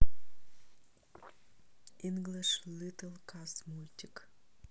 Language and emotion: Russian, neutral